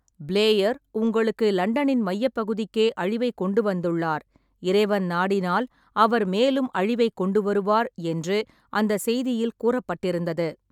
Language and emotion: Tamil, neutral